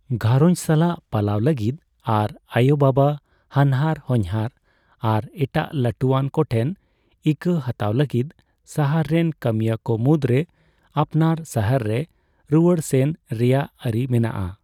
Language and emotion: Santali, neutral